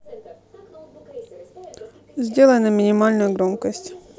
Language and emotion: Russian, neutral